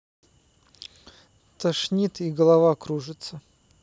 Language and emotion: Russian, neutral